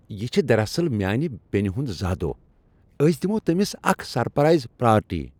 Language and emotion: Kashmiri, happy